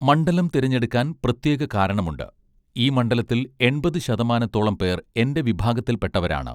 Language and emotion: Malayalam, neutral